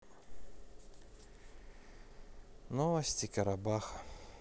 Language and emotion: Russian, sad